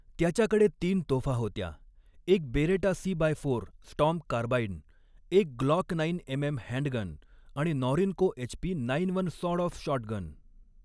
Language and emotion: Marathi, neutral